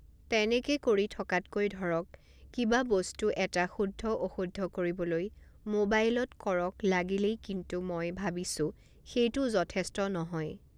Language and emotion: Assamese, neutral